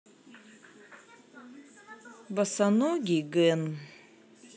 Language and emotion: Russian, neutral